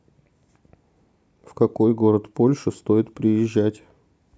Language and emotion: Russian, neutral